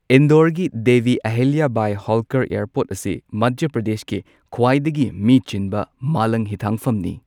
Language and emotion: Manipuri, neutral